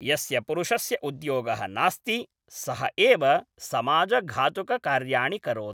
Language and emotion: Sanskrit, neutral